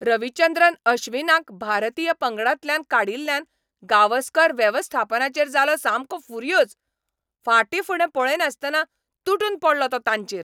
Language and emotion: Goan Konkani, angry